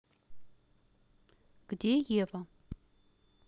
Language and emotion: Russian, neutral